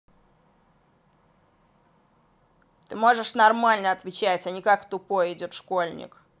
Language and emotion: Russian, angry